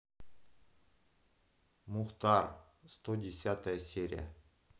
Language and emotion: Russian, neutral